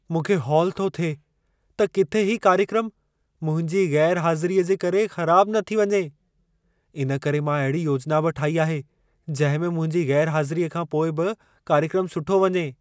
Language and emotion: Sindhi, fearful